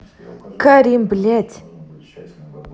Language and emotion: Russian, angry